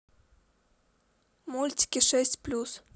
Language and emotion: Russian, neutral